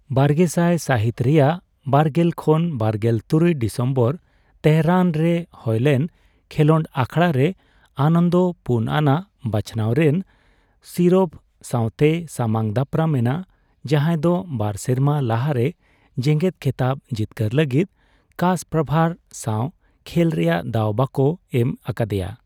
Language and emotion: Santali, neutral